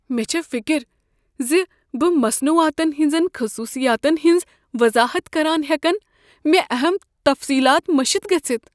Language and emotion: Kashmiri, fearful